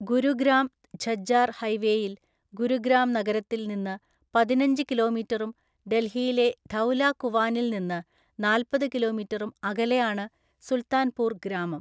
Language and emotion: Malayalam, neutral